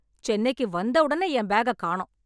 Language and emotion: Tamil, angry